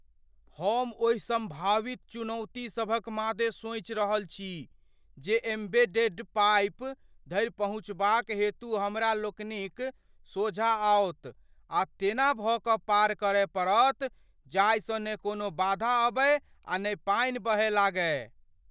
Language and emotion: Maithili, fearful